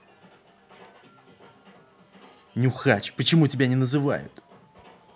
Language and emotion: Russian, angry